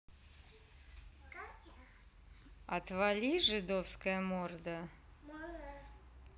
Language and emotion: Russian, neutral